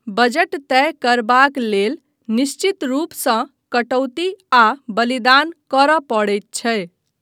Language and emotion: Maithili, neutral